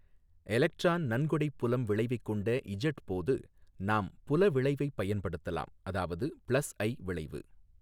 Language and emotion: Tamil, neutral